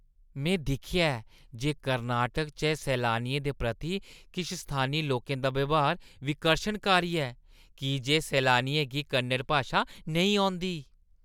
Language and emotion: Dogri, disgusted